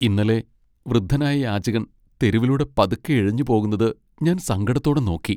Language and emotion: Malayalam, sad